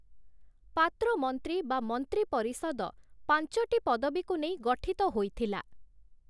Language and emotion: Odia, neutral